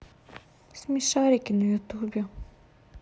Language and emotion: Russian, sad